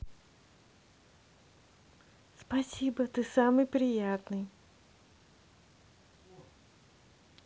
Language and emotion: Russian, positive